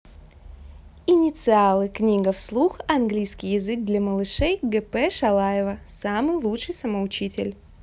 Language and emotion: Russian, positive